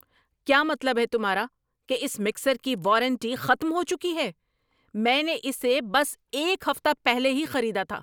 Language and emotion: Urdu, angry